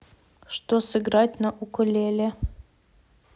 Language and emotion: Russian, neutral